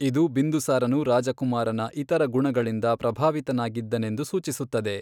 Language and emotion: Kannada, neutral